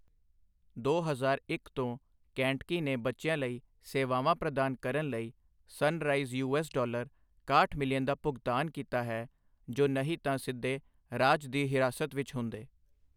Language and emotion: Punjabi, neutral